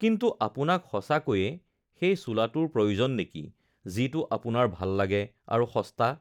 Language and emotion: Assamese, neutral